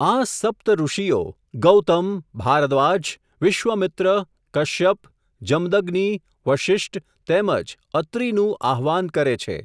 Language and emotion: Gujarati, neutral